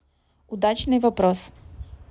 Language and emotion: Russian, neutral